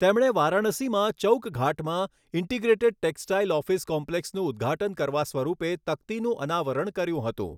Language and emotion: Gujarati, neutral